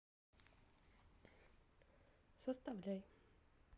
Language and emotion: Russian, neutral